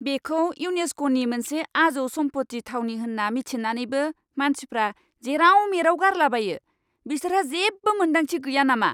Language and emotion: Bodo, angry